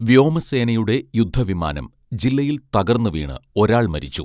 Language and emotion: Malayalam, neutral